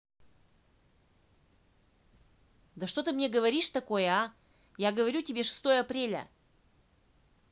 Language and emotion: Russian, angry